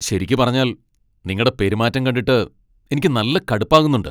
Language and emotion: Malayalam, angry